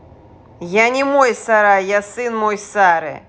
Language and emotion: Russian, angry